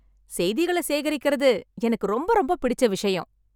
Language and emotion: Tamil, happy